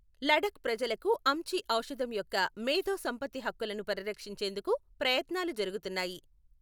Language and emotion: Telugu, neutral